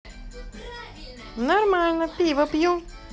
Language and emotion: Russian, positive